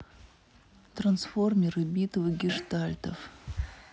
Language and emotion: Russian, neutral